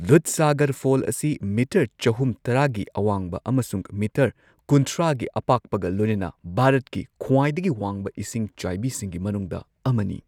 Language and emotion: Manipuri, neutral